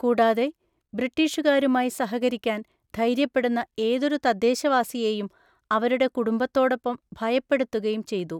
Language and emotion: Malayalam, neutral